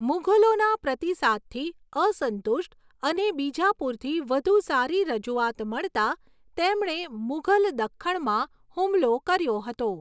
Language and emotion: Gujarati, neutral